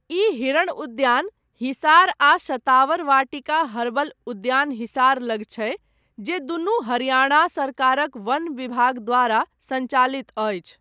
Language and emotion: Maithili, neutral